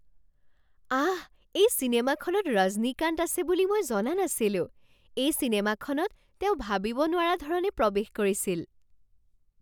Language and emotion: Assamese, surprised